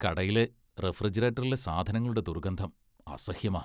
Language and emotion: Malayalam, disgusted